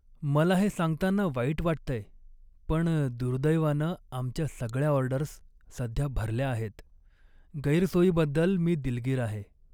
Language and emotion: Marathi, sad